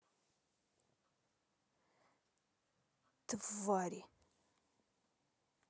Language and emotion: Russian, angry